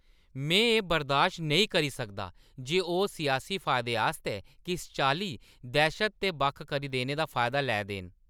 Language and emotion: Dogri, angry